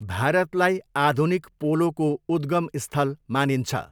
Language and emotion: Nepali, neutral